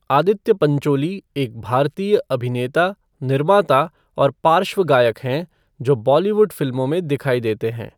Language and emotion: Hindi, neutral